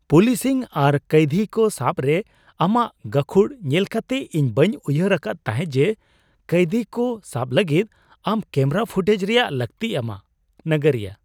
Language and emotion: Santali, surprised